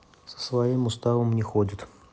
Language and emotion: Russian, neutral